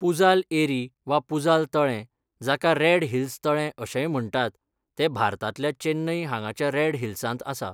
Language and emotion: Goan Konkani, neutral